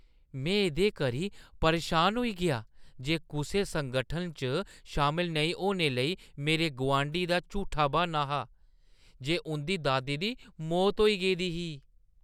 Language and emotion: Dogri, disgusted